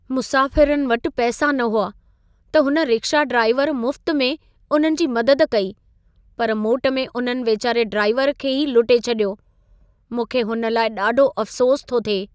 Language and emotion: Sindhi, sad